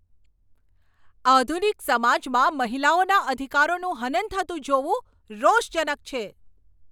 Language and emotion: Gujarati, angry